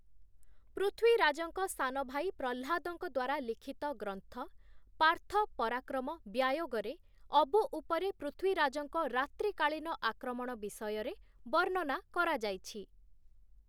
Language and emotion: Odia, neutral